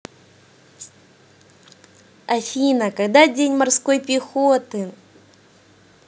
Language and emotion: Russian, positive